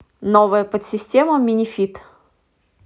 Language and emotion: Russian, neutral